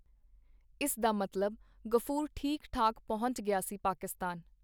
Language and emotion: Punjabi, neutral